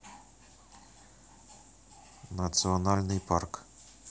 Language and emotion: Russian, neutral